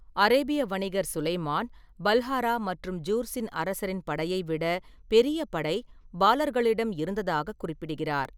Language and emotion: Tamil, neutral